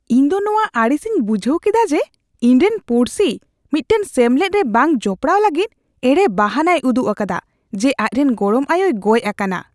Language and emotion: Santali, disgusted